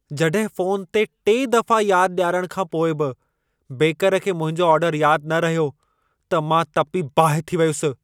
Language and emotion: Sindhi, angry